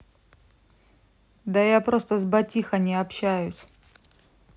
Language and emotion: Russian, neutral